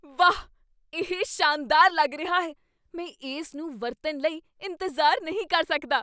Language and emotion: Punjabi, surprised